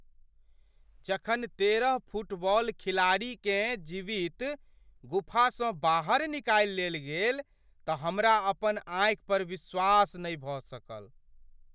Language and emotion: Maithili, surprised